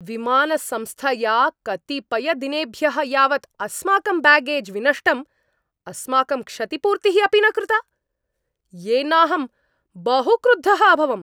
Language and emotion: Sanskrit, angry